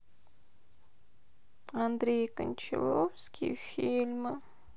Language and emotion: Russian, sad